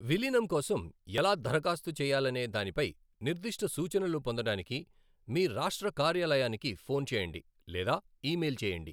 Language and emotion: Telugu, neutral